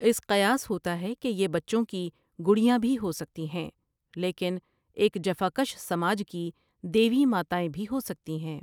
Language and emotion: Urdu, neutral